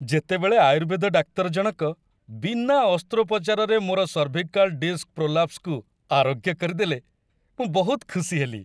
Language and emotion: Odia, happy